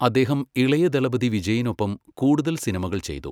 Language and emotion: Malayalam, neutral